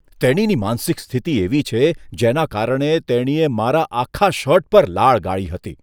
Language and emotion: Gujarati, disgusted